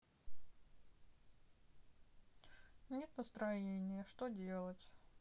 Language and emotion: Russian, sad